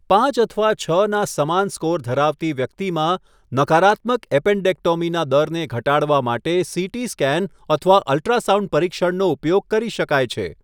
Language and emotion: Gujarati, neutral